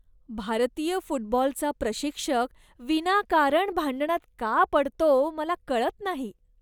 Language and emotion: Marathi, disgusted